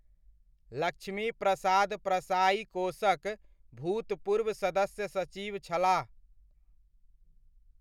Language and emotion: Maithili, neutral